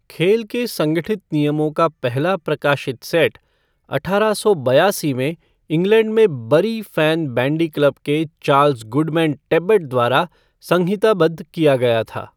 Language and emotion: Hindi, neutral